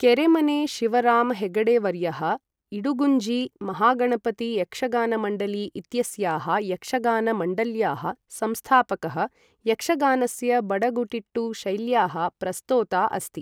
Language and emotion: Sanskrit, neutral